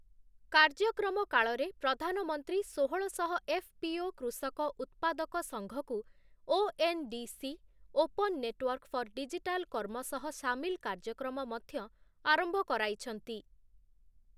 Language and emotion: Odia, neutral